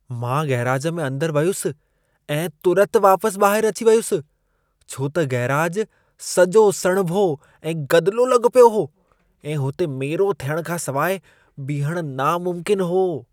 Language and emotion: Sindhi, disgusted